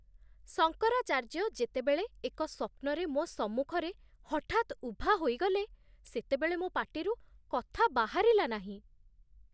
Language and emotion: Odia, surprised